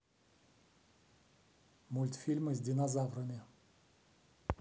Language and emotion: Russian, neutral